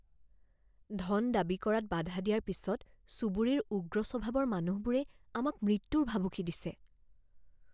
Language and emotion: Assamese, fearful